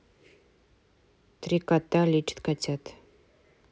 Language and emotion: Russian, neutral